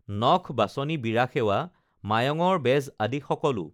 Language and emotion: Assamese, neutral